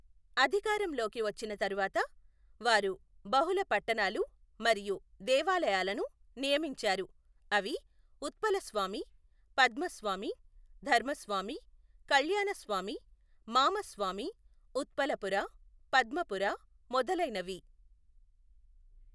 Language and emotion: Telugu, neutral